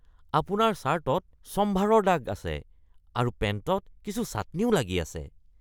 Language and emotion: Assamese, disgusted